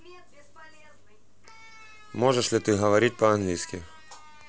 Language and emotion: Russian, neutral